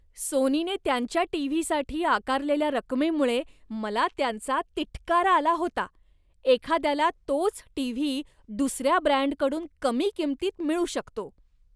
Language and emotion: Marathi, disgusted